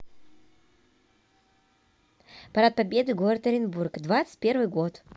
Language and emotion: Russian, neutral